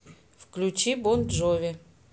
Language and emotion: Russian, neutral